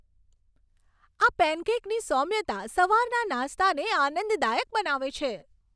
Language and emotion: Gujarati, happy